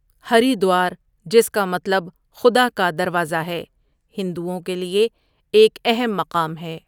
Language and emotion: Urdu, neutral